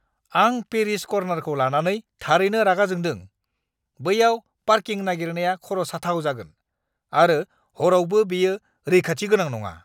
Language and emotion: Bodo, angry